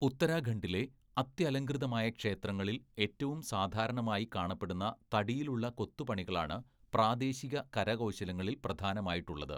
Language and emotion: Malayalam, neutral